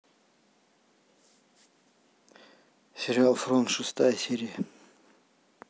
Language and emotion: Russian, neutral